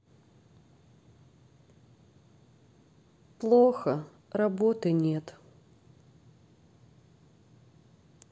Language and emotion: Russian, sad